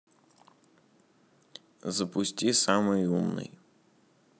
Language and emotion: Russian, neutral